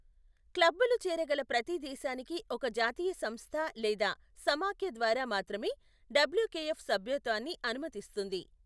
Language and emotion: Telugu, neutral